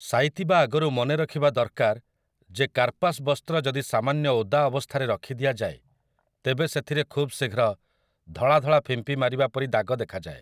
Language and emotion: Odia, neutral